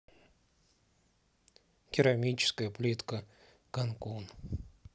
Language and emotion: Russian, neutral